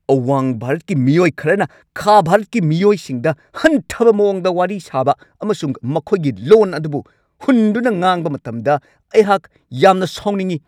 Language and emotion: Manipuri, angry